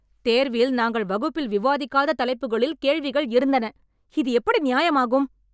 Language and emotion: Tamil, angry